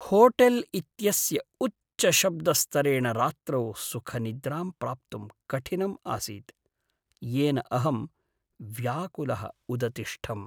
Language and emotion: Sanskrit, sad